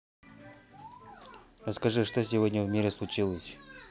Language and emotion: Russian, neutral